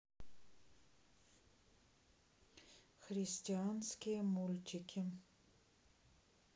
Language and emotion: Russian, neutral